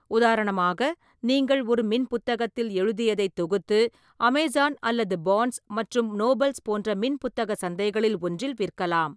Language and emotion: Tamil, neutral